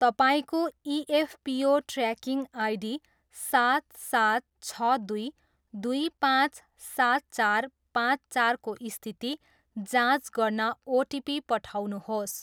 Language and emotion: Nepali, neutral